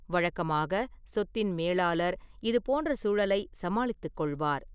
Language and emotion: Tamil, neutral